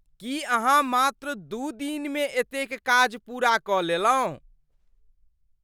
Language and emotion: Maithili, surprised